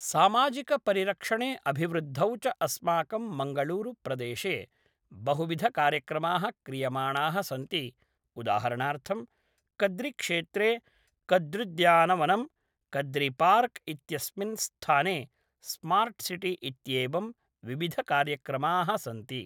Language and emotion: Sanskrit, neutral